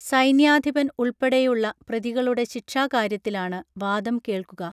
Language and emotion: Malayalam, neutral